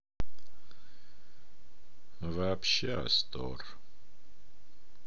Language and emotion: Russian, sad